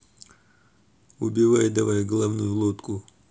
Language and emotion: Russian, angry